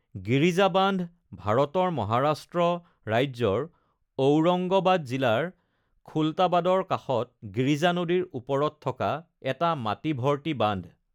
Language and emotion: Assamese, neutral